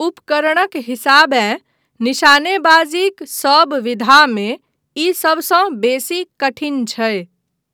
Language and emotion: Maithili, neutral